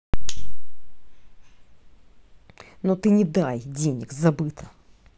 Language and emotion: Russian, angry